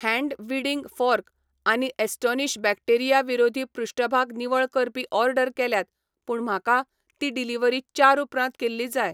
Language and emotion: Goan Konkani, neutral